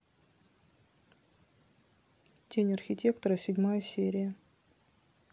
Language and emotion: Russian, neutral